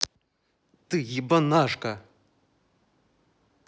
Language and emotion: Russian, angry